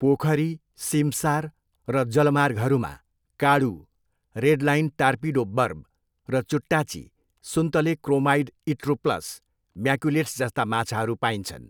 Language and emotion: Nepali, neutral